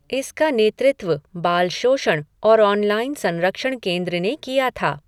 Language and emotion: Hindi, neutral